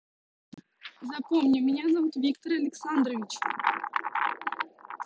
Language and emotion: Russian, neutral